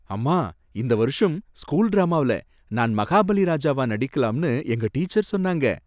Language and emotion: Tamil, happy